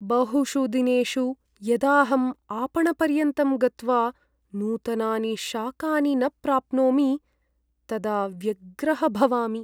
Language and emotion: Sanskrit, sad